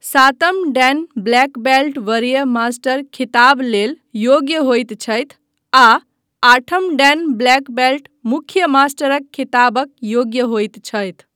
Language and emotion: Maithili, neutral